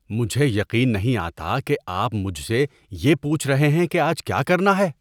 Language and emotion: Urdu, disgusted